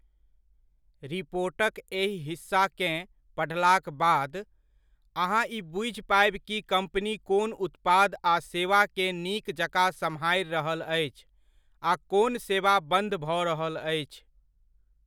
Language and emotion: Maithili, neutral